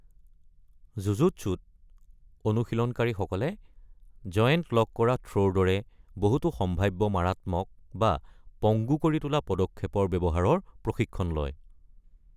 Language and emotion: Assamese, neutral